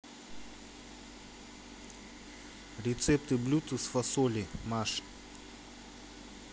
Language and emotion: Russian, neutral